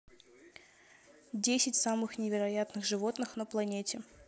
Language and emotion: Russian, neutral